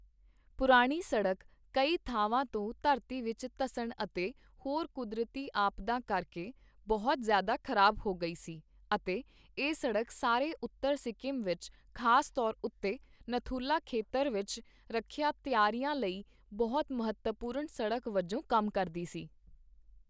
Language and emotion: Punjabi, neutral